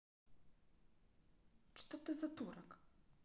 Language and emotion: Russian, angry